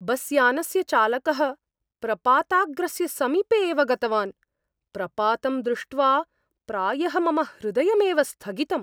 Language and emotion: Sanskrit, fearful